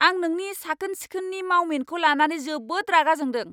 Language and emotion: Bodo, angry